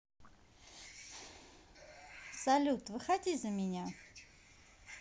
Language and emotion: Russian, positive